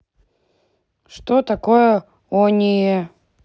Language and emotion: Russian, neutral